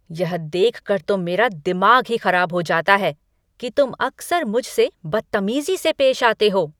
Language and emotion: Hindi, angry